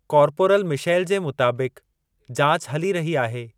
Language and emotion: Sindhi, neutral